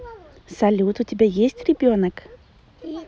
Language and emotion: Russian, positive